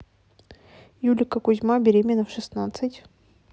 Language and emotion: Russian, neutral